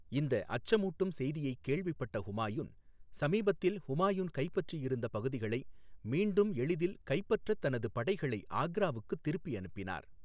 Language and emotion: Tamil, neutral